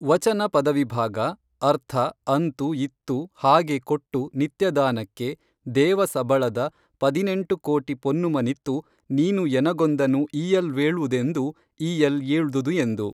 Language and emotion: Kannada, neutral